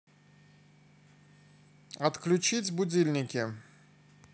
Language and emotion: Russian, neutral